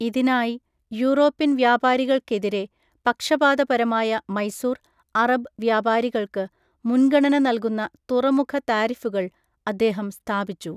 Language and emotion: Malayalam, neutral